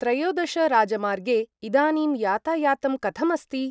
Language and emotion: Sanskrit, neutral